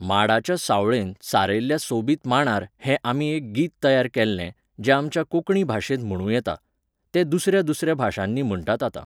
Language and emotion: Goan Konkani, neutral